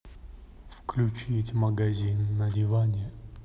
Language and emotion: Russian, neutral